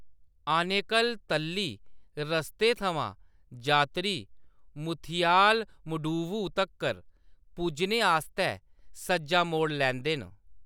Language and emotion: Dogri, neutral